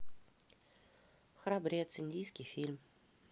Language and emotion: Russian, neutral